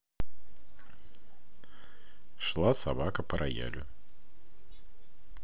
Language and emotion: Russian, neutral